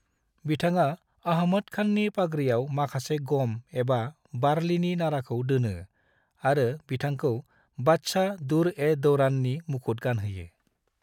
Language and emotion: Bodo, neutral